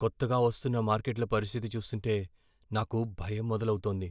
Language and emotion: Telugu, fearful